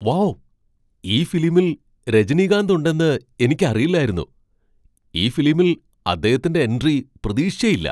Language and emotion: Malayalam, surprised